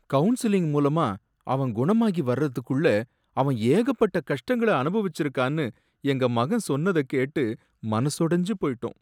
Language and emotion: Tamil, sad